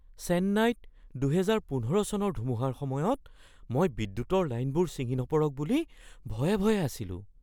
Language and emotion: Assamese, fearful